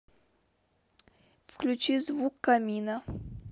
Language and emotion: Russian, neutral